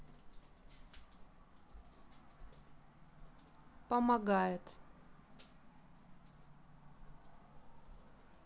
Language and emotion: Russian, neutral